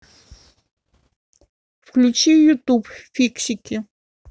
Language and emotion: Russian, neutral